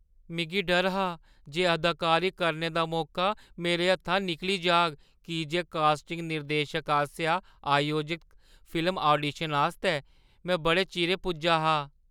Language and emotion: Dogri, fearful